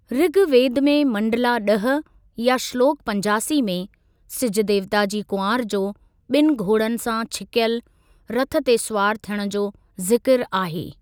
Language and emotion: Sindhi, neutral